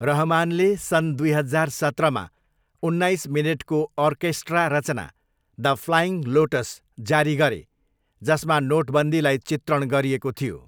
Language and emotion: Nepali, neutral